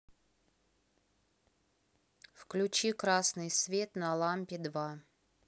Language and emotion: Russian, neutral